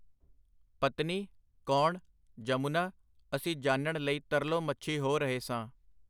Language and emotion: Punjabi, neutral